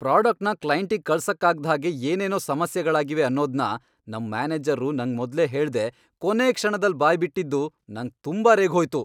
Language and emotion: Kannada, angry